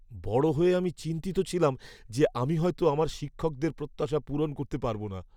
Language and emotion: Bengali, fearful